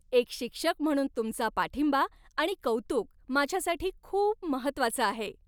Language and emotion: Marathi, happy